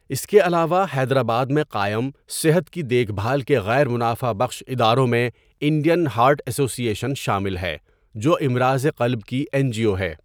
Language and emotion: Urdu, neutral